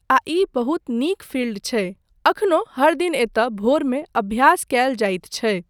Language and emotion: Maithili, neutral